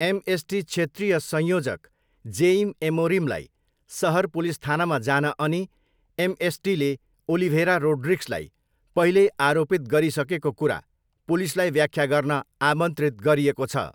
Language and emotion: Nepali, neutral